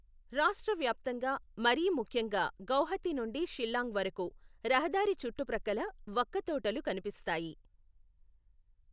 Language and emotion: Telugu, neutral